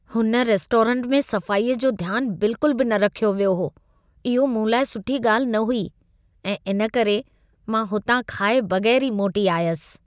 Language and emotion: Sindhi, disgusted